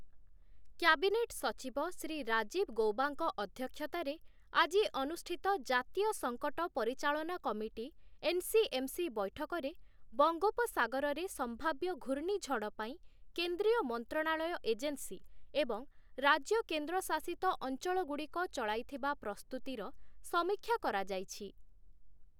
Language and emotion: Odia, neutral